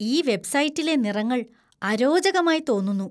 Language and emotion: Malayalam, disgusted